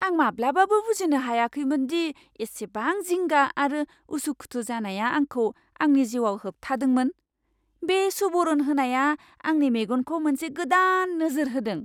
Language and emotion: Bodo, surprised